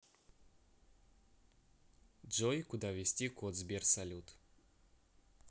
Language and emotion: Russian, neutral